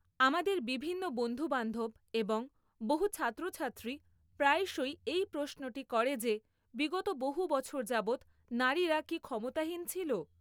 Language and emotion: Bengali, neutral